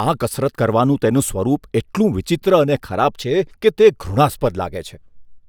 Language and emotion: Gujarati, disgusted